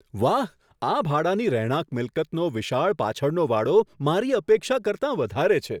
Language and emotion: Gujarati, surprised